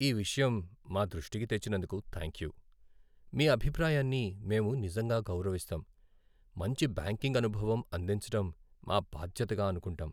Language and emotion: Telugu, sad